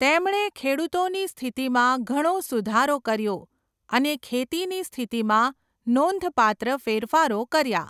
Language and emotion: Gujarati, neutral